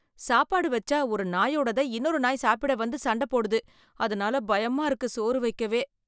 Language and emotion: Tamil, fearful